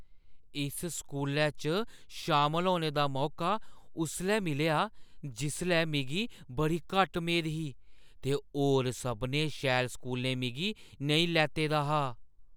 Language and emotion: Dogri, surprised